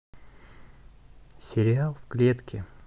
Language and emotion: Russian, neutral